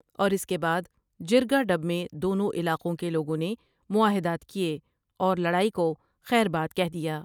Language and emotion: Urdu, neutral